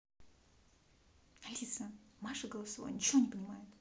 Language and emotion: Russian, angry